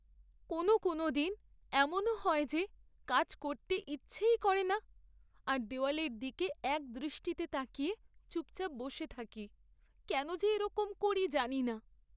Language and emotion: Bengali, sad